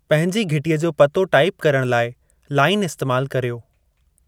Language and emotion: Sindhi, neutral